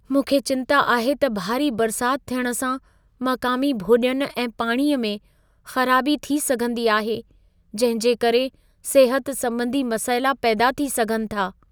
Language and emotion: Sindhi, fearful